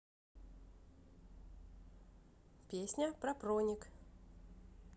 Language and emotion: Russian, neutral